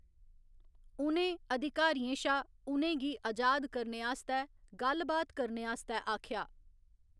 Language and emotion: Dogri, neutral